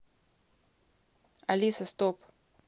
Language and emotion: Russian, neutral